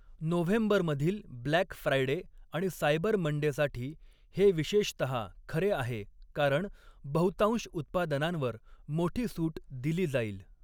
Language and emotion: Marathi, neutral